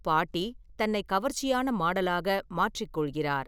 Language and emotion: Tamil, neutral